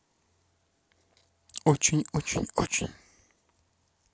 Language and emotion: Russian, neutral